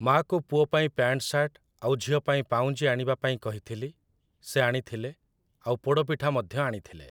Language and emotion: Odia, neutral